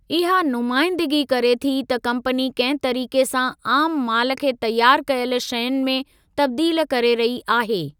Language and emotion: Sindhi, neutral